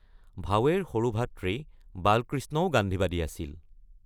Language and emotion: Assamese, neutral